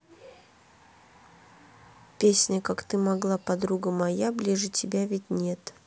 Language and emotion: Russian, neutral